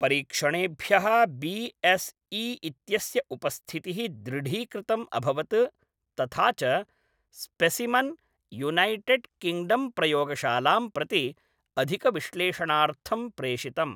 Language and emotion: Sanskrit, neutral